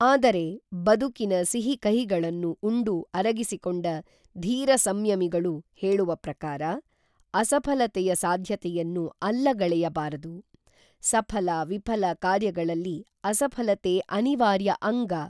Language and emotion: Kannada, neutral